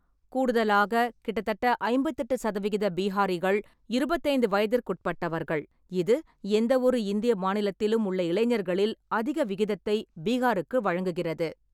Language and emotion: Tamil, neutral